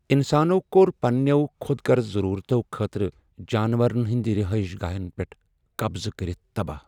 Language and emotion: Kashmiri, sad